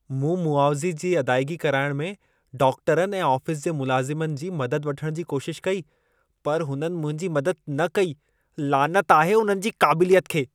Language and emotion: Sindhi, disgusted